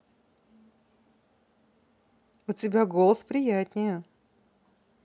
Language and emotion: Russian, positive